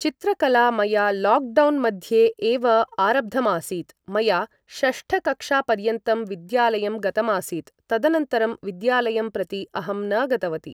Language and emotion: Sanskrit, neutral